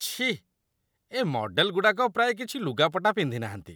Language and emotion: Odia, disgusted